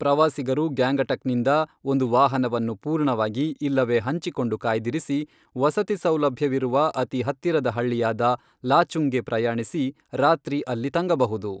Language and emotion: Kannada, neutral